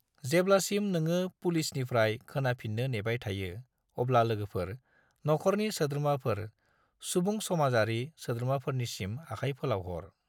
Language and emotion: Bodo, neutral